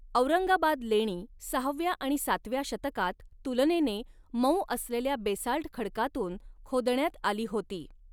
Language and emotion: Marathi, neutral